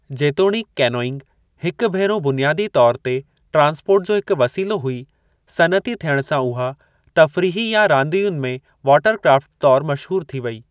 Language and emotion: Sindhi, neutral